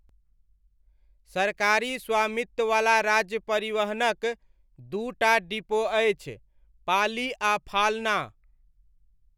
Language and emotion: Maithili, neutral